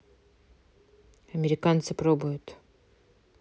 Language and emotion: Russian, neutral